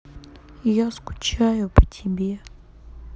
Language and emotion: Russian, sad